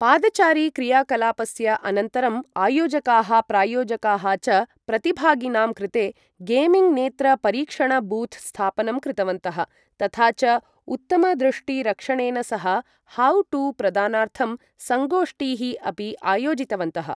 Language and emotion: Sanskrit, neutral